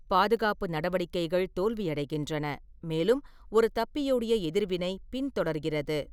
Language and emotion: Tamil, neutral